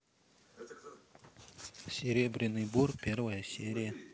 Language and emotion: Russian, neutral